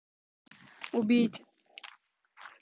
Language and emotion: Russian, neutral